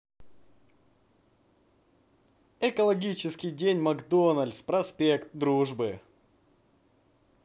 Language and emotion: Russian, positive